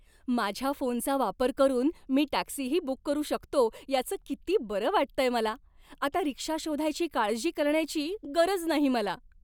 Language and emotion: Marathi, happy